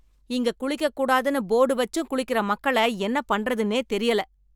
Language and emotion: Tamil, angry